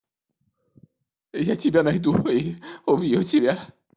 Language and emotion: Russian, angry